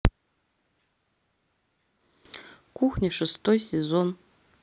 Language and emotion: Russian, neutral